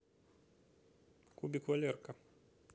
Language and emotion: Russian, neutral